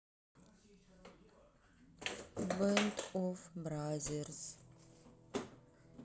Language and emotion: Russian, sad